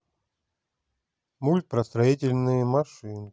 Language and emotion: Russian, neutral